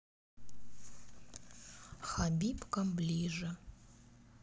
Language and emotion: Russian, neutral